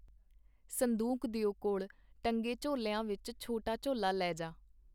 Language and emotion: Punjabi, neutral